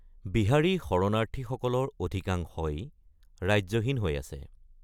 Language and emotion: Assamese, neutral